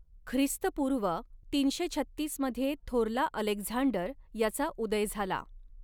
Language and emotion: Marathi, neutral